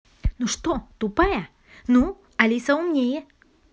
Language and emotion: Russian, angry